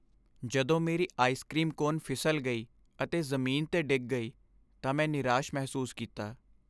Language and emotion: Punjabi, sad